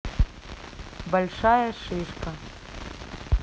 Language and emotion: Russian, neutral